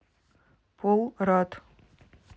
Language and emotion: Russian, neutral